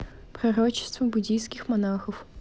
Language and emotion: Russian, neutral